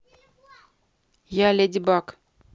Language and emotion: Russian, neutral